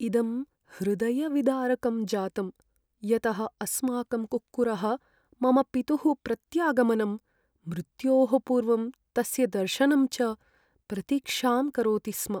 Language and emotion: Sanskrit, sad